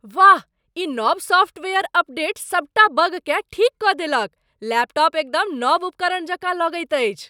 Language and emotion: Maithili, surprised